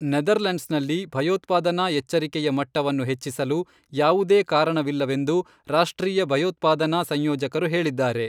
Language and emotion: Kannada, neutral